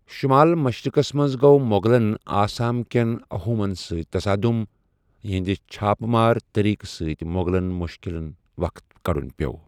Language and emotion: Kashmiri, neutral